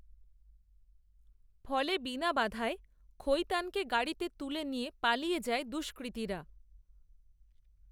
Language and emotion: Bengali, neutral